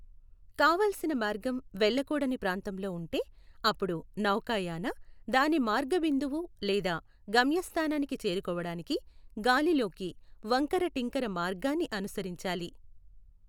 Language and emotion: Telugu, neutral